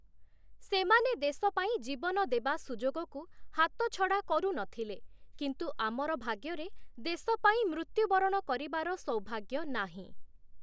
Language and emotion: Odia, neutral